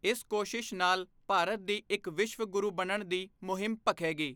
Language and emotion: Punjabi, neutral